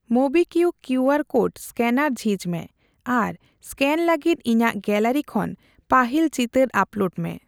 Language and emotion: Santali, neutral